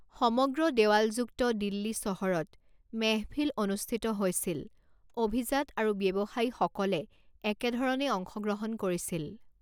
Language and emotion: Assamese, neutral